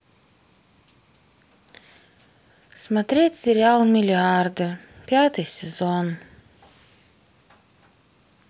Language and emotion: Russian, sad